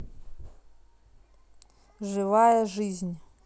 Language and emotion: Russian, neutral